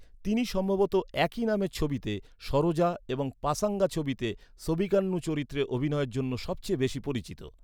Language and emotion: Bengali, neutral